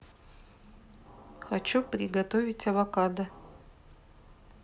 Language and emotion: Russian, neutral